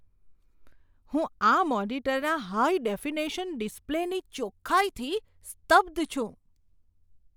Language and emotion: Gujarati, surprised